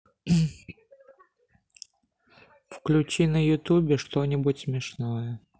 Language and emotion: Russian, sad